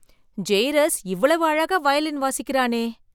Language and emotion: Tamil, surprised